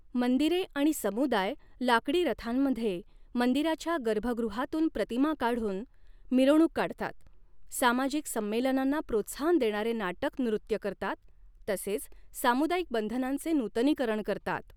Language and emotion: Marathi, neutral